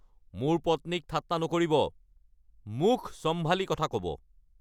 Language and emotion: Assamese, angry